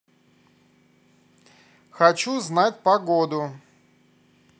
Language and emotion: Russian, neutral